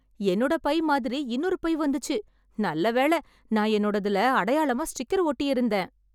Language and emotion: Tamil, happy